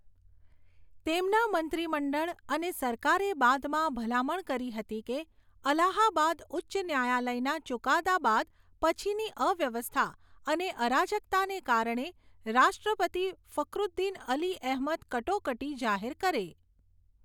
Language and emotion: Gujarati, neutral